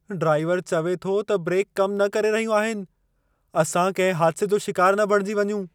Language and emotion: Sindhi, fearful